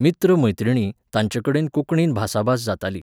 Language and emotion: Goan Konkani, neutral